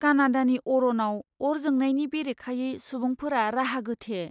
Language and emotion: Bodo, fearful